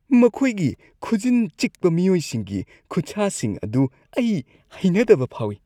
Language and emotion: Manipuri, disgusted